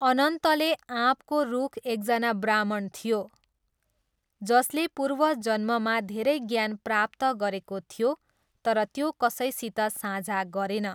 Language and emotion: Nepali, neutral